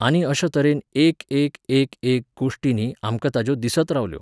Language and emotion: Goan Konkani, neutral